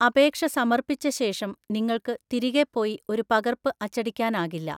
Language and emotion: Malayalam, neutral